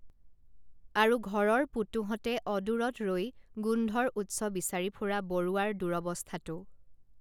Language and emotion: Assamese, neutral